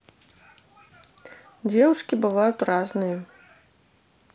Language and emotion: Russian, neutral